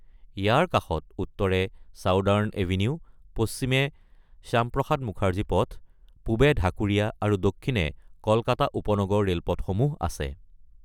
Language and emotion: Assamese, neutral